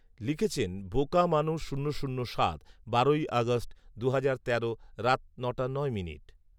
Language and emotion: Bengali, neutral